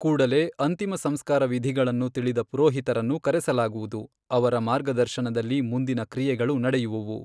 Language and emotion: Kannada, neutral